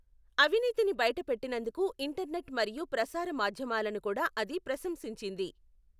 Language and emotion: Telugu, neutral